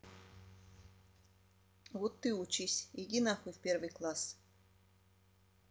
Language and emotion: Russian, angry